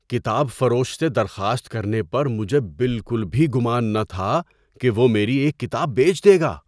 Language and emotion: Urdu, surprised